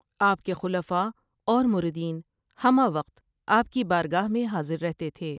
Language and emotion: Urdu, neutral